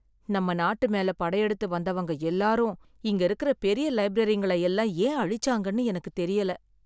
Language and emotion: Tamil, sad